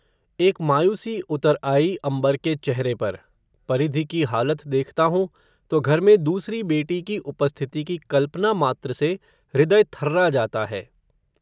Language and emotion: Hindi, neutral